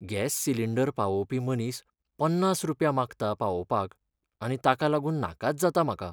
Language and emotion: Goan Konkani, sad